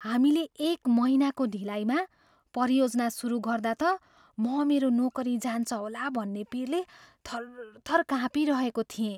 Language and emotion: Nepali, fearful